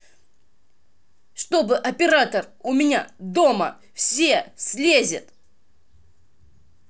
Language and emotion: Russian, angry